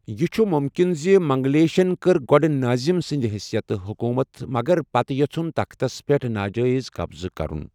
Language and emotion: Kashmiri, neutral